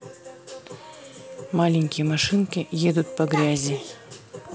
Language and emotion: Russian, neutral